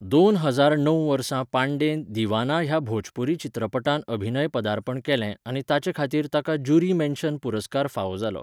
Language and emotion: Goan Konkani, neutral